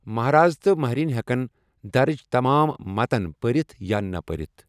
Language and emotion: Kashmiri, neutral